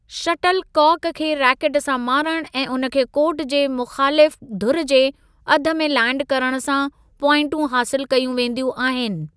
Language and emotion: Sindhi, neutral